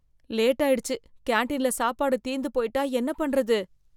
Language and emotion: Tamil, fearful